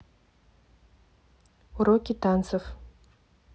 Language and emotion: Russian, neutral